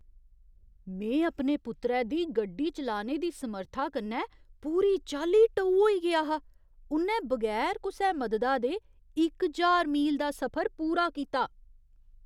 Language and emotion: Dogri, surprised